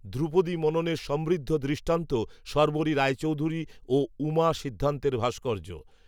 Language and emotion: Bengali, neutral